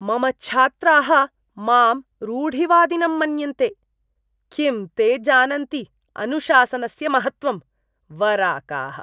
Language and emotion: Sanskrit, disgusted